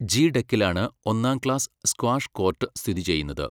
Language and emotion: Malayalam, neutral